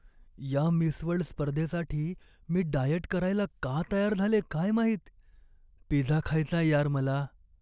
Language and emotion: Marathi, sad